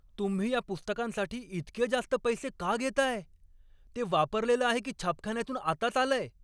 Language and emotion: Marathi, angry